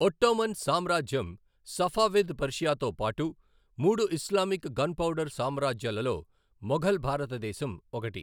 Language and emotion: Telugu, neutral